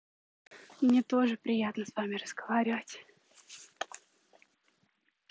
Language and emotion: Russian, neutral